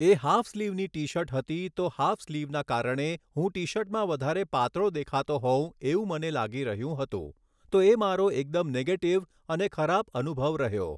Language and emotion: Gujarati, neutral